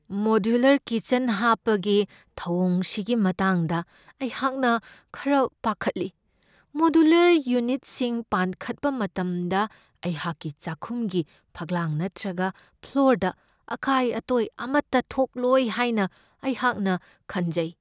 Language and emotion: Manipuri, fearful